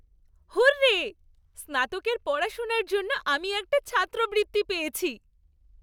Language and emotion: Bengali, happy